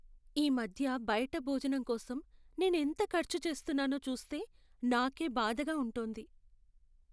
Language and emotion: Telugu, sad